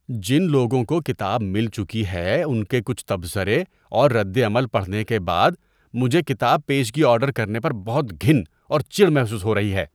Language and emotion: Urdu, disgusted